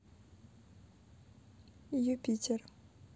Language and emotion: Russian, neutral